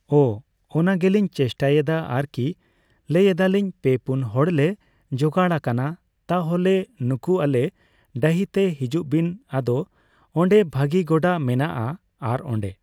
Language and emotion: Santali, neutral